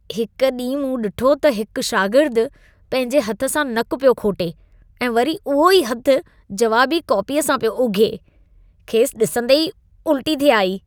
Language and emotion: Sindhi, disgusted